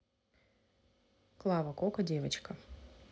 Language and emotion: Russian, neutral